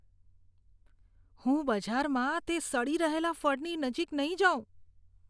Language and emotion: Gujarati, disgusted